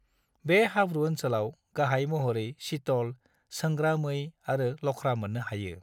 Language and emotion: Bodo, neutral